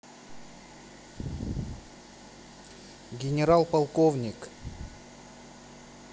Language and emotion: Russian, neutral